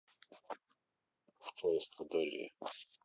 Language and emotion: Russian, neutral